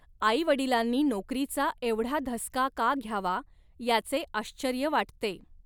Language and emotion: Marathi, neutral